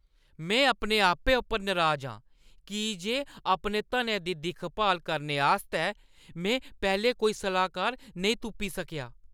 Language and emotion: Dogri, angry